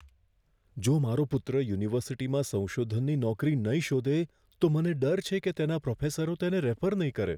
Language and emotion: Gujarati, fearful